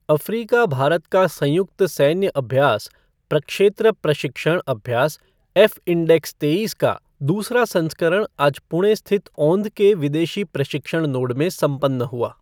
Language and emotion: Hindi, neutral